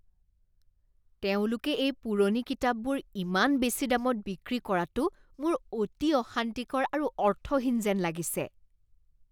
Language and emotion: Assamese, disgusted